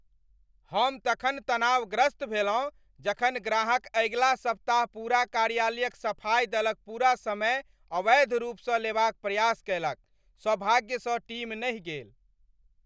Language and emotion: Maithili, angry